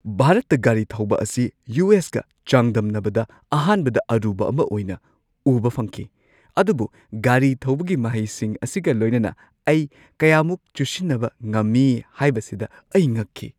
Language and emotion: Manipuri, surprised